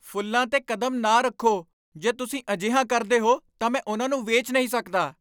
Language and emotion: Punjabi, angry